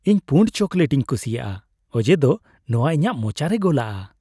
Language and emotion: Santali, happy